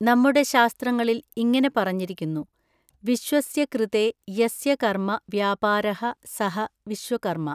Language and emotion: Malayalam, neutral